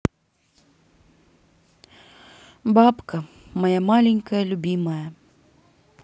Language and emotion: Russian, sad